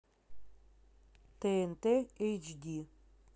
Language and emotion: Russian, neutral